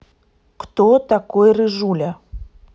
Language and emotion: Russian, neutral